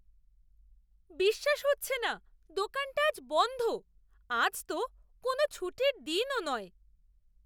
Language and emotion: Bengali, surprised